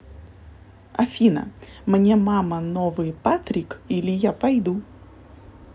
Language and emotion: Russian, positive